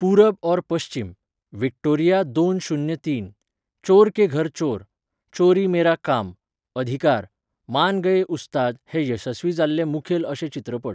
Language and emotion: Goan Konkani, neutral